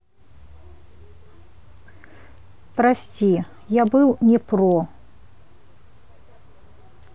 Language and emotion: Russian, neutral